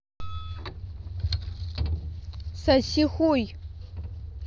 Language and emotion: Russian, angry